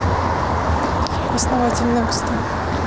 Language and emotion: Russian, neutral